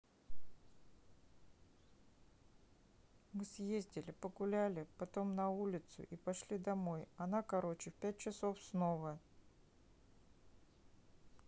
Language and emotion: Russian, neutral